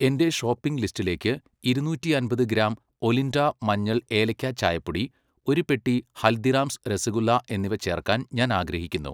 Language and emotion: Malayalam, neutral